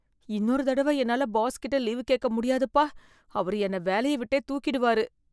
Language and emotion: Tamil, fearful